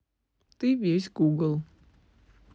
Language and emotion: Russian, neutral